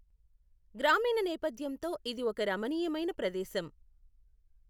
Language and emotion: Telugu, neutral